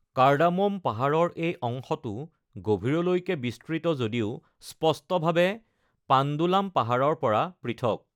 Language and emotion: Assamese, neutral